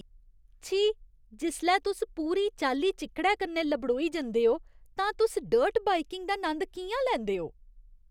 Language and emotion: Dogri, disgusted